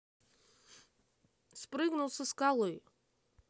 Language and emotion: Russian, neutral